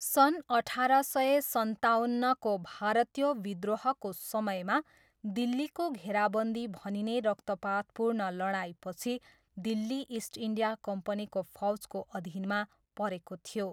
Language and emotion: Nepali, neutral